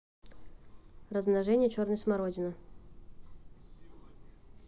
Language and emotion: Russian, neutral